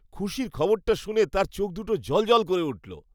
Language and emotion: Bengali, happy